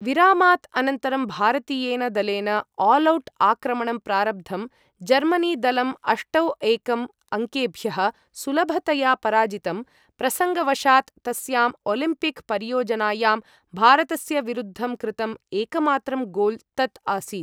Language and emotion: Sanskrit, neutral